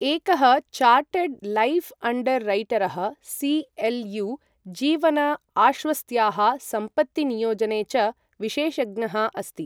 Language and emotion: Sanskrit, neutral